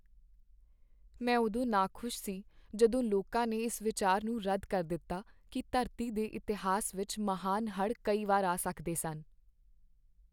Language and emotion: Punjabi, sad